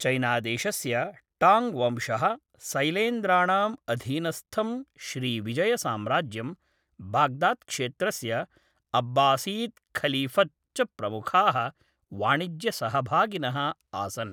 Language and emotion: Sanskrit, neutral